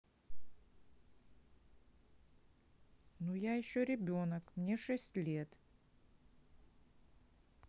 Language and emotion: Russian, sad